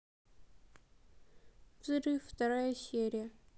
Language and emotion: Russian, sad